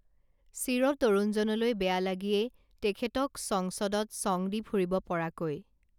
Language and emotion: Assamese, neutral